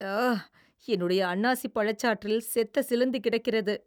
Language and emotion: Tamil, disgusted